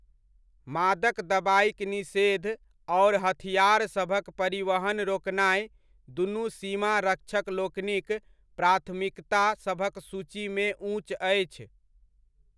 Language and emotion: Maithili, neutral